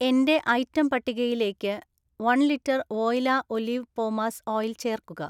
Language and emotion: Malayalam, neutral